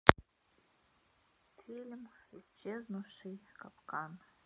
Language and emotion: Russian, sad